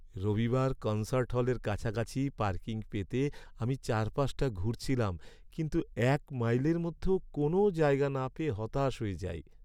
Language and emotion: Bengali, sad